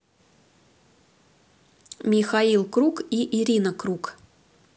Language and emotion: Russian, neutral